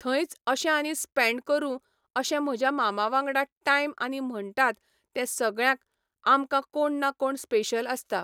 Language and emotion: Goan Konkani, neutral